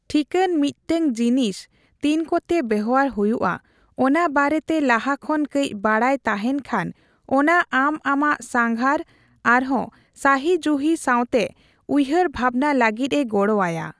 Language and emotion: Santali, neutral